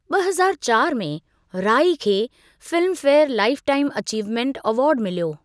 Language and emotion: Sindhi, neutral